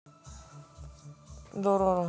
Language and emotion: Russian, neutral